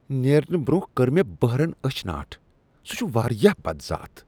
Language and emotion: Kashmiri, disgusted